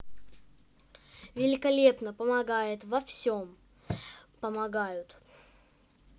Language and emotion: Russian, positive